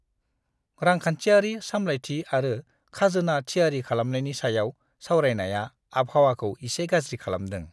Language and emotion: Bodo, disgusted